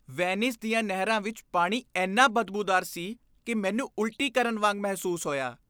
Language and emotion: Punjabi, disgusted